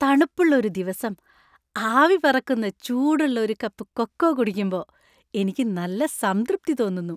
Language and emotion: Malayalam, happy